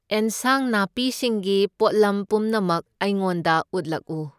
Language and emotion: Manipuri, neutral